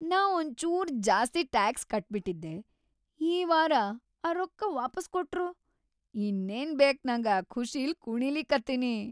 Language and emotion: Kannada, happy